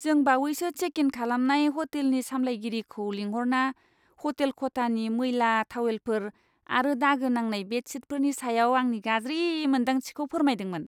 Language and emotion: Bodo, disgusted